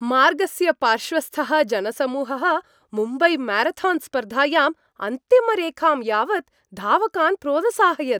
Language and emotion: Sanskrit, happy